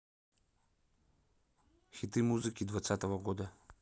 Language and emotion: Russian, neutral